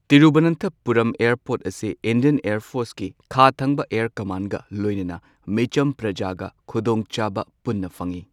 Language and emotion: Manipuri, neutral